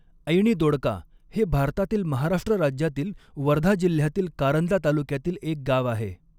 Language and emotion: Marathi, neutral